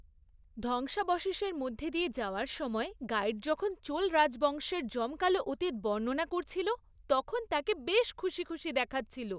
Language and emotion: Bengali, happy